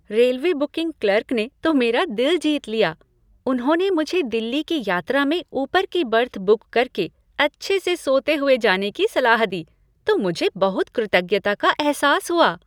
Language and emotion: Hindi, happy